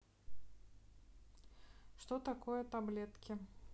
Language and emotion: Russian, neutral